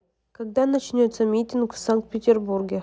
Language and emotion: Russian, neutral